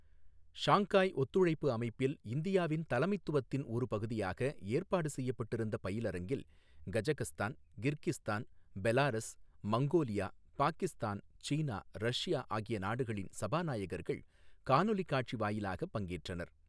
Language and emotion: Tamil, neutral